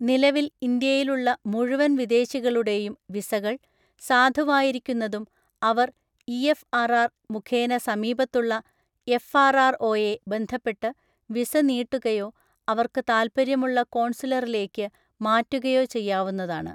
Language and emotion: Malayalam, neutral